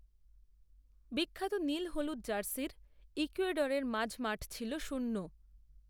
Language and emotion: Bengali, neutral